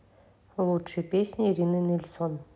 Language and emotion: Russian, neutral